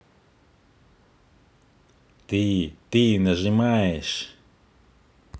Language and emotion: Russian, angry